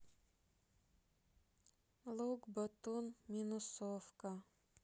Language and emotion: Russian, sad